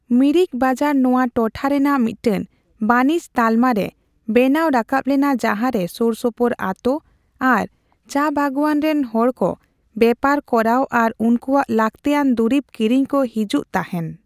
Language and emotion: Santali, neutral